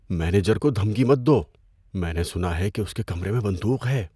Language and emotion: Urdu, fearful